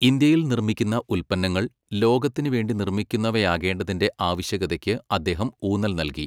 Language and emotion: Malayalam, neutral